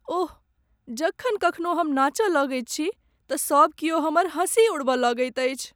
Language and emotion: Maithili, sad